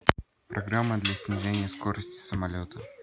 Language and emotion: Russian, neutral